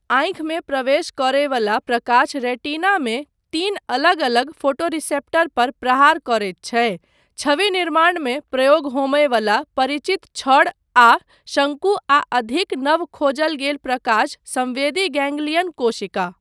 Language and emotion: Maithili, neutral